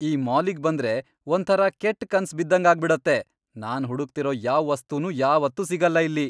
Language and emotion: Kannada, angry